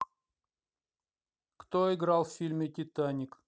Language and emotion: Russian, neutral